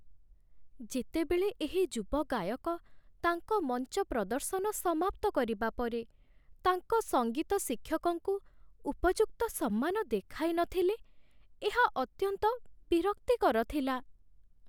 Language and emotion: Odia, sad